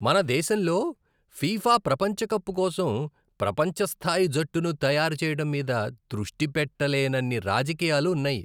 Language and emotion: Telugu, disgusted